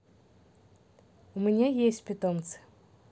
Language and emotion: Russian, neutral